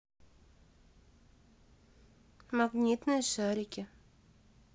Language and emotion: Russian, neutral